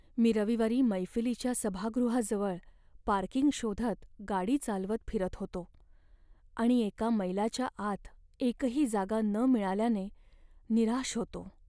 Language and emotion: Marathi, sad